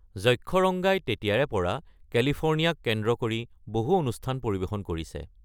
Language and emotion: Assamese, neutral